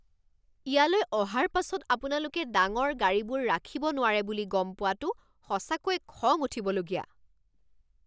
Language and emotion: Assamese, angry